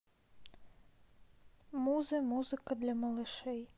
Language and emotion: Russian, neutral